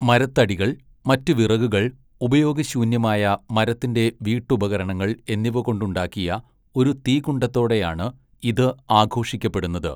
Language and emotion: Malayalam, neutral